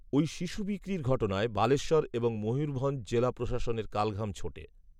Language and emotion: Bengali, neutral